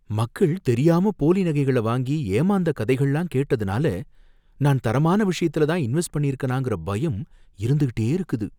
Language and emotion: Tamil, fearful